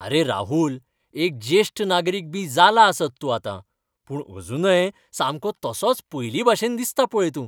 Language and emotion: Goan Konkani, happy